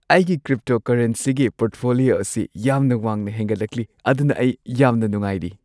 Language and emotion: Manipuri, happy